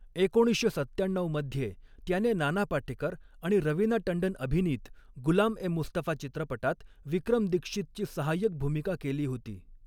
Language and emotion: Marathi, neutral